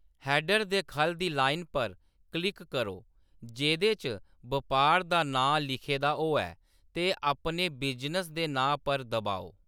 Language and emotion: Dogri, neutral